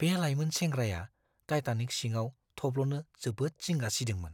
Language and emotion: Bodo, fearful